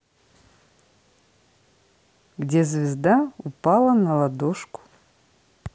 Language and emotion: Russian, neutral